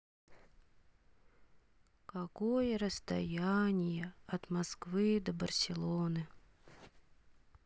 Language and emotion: Russian, sad